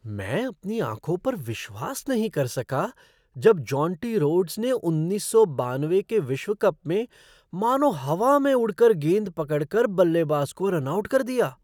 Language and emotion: Hindi, surprised